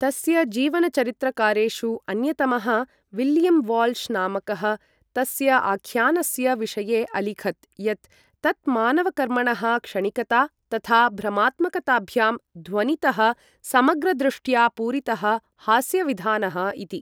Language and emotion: Sanskrit, neutral